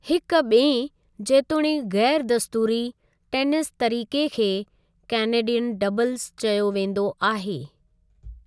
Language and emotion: Sindhi, neutral